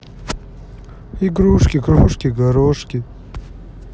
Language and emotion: Russian, sad